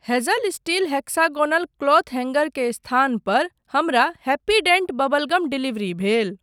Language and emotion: Maithili, neutral